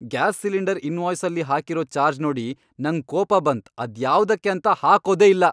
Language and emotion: Kannada, angry